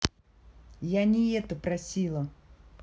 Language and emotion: Russian, angry